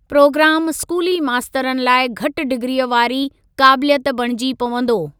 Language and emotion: Sindhi, neutral